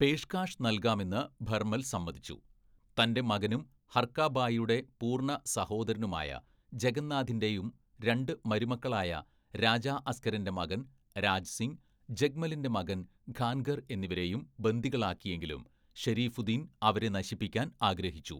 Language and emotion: Malayalam, neutral